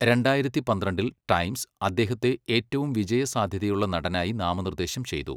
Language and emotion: Malayalam, neutral